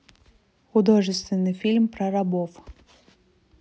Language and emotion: Russian, neutral